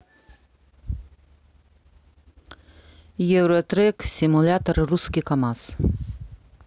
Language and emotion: Russian, neutral